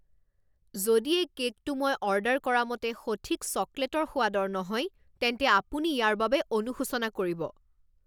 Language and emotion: Assamese, angry